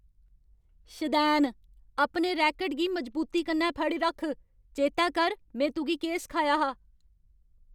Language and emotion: Dogri, angry